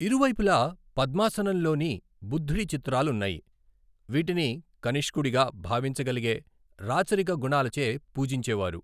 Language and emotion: Telugu, neutral